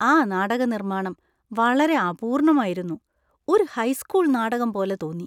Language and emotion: Malayalam, disgusted